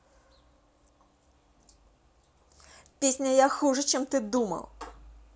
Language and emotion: Russian, angry